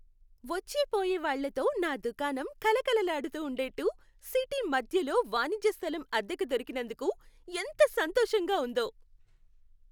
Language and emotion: Telugu, happy